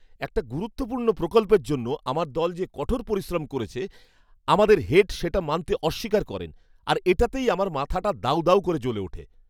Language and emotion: Bengali, angry